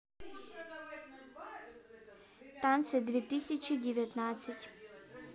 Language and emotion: Russian, neutral